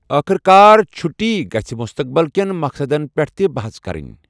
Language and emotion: Kashmiri, neutral